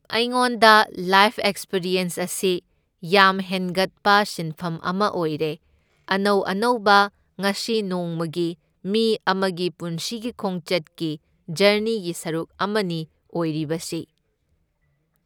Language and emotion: Manipuri, neutral